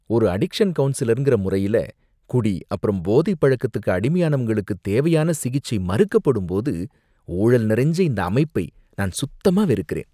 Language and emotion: Tamil, disgusted